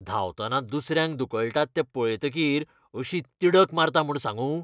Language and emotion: Goan Konkani, angry